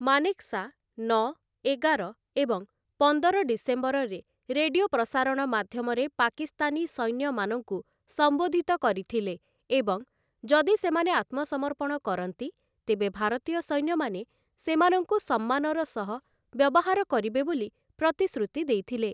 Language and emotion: Odia, neutral